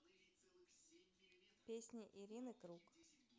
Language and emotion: Russian, neutral